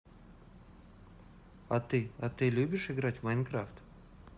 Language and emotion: Russian, neutral